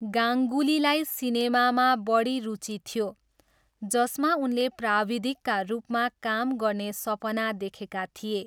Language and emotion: Nepali, neutral